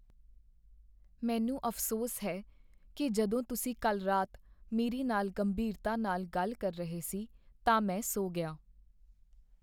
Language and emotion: Punjabi, sad